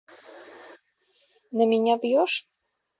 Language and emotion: Russian, neutral